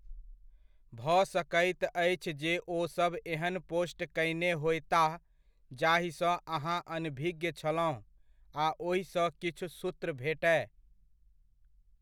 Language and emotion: Maithili, neutral